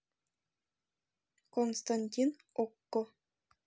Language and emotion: Russian, neutral